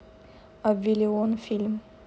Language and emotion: Russian, neutral